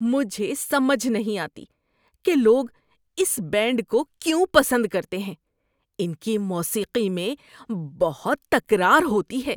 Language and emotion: Urdu, disgusted